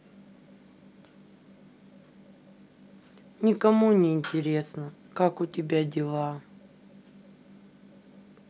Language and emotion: Russian, sad